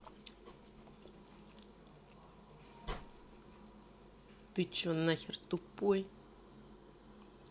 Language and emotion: Russian, angry